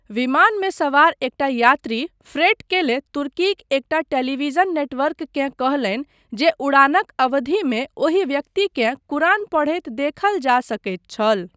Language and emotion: Maithili, neutral